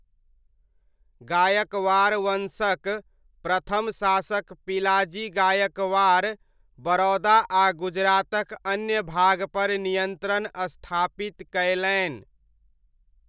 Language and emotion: Maithili, neutral